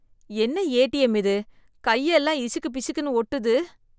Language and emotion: Tamil, disgusted